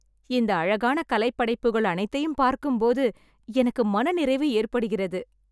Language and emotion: Tamil, happy